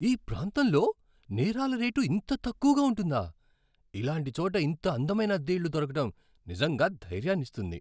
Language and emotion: Telugu, surprised